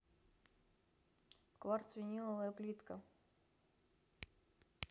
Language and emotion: Russian, neutral